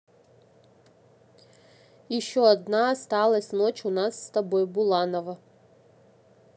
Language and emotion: Russian, neutral